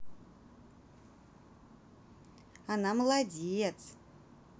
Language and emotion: Russian, positive